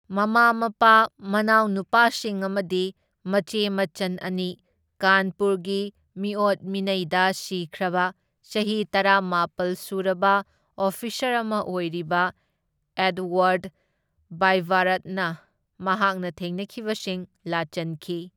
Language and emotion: Manipuri, neutral